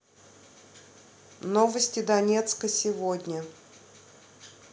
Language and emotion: Russian, neutral